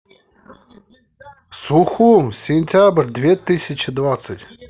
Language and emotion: Russian, positive